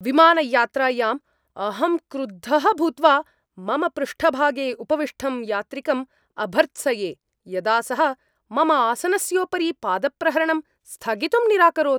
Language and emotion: Sanskrit, angry